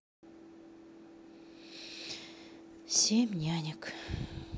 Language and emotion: Russian, sad